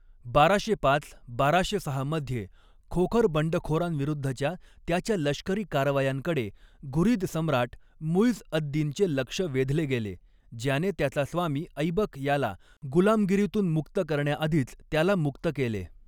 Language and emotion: Marathi, neutral